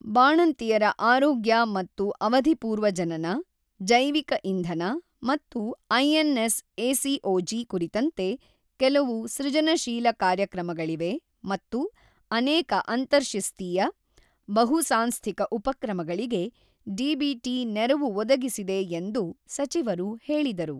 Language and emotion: Kannada, neutral